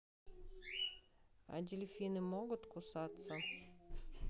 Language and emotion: Russian, neutral